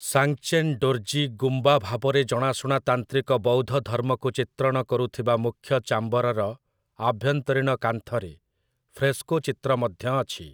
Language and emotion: Odia, neutral